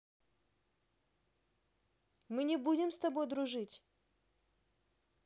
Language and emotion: Russian, neutral